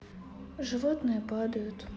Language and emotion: Russian, sad